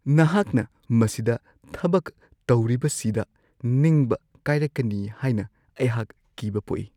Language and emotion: Manipuri, fearful